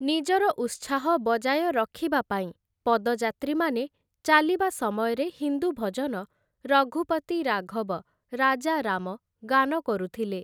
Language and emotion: Odia, neutral